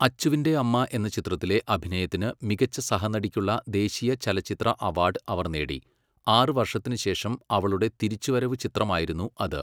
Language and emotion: Malayalam, neutral